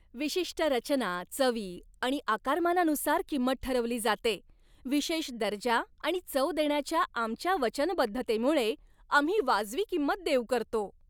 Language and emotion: Marathi, happy